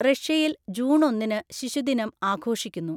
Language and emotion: Malayalam, neutral